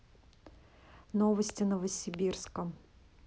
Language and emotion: Russian, neutral